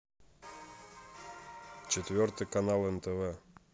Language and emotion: Russian, neutral